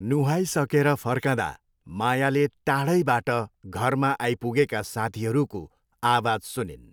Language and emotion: Nepali, neutral